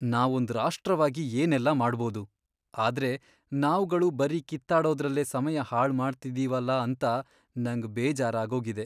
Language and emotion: Kannada, sad